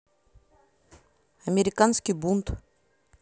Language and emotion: Russian, neutral